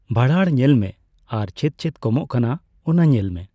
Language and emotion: Santali, neutral